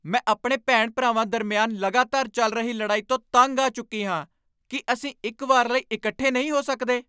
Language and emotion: Punjabi, angry